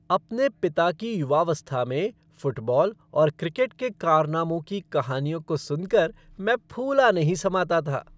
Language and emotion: Hindi, happy